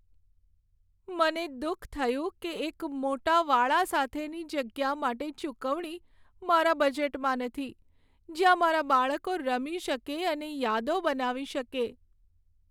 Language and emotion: Gujarati, sad